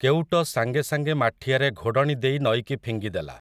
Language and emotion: Odia, neutral